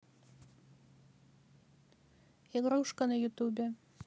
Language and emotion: Russian, neutral